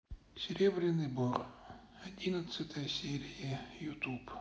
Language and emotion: Russian, sad